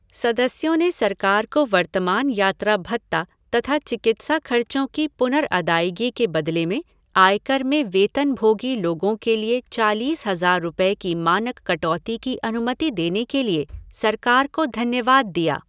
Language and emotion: Hindi, neutral